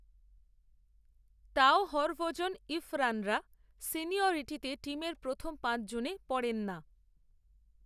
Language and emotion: Bengali, neutral